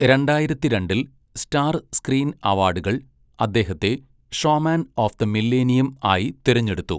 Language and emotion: Malayalam, neutral